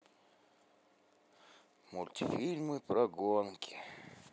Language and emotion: Russian, sad